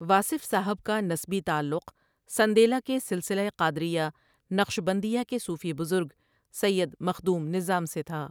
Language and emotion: Urdu, neutral